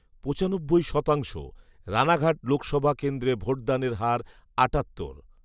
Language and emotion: Bengali, neutral